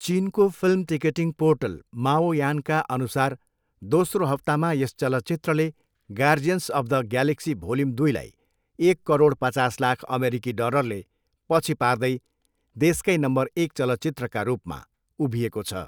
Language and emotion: Nepali, neutral